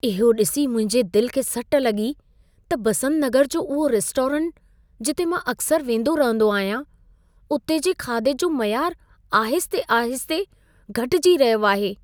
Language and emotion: Sindhi, sad